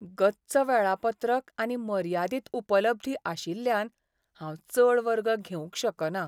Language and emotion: Goan Konkani, sad